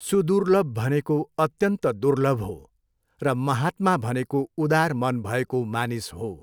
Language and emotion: Nepali, neutral